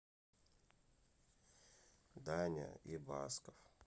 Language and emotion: Russian, sad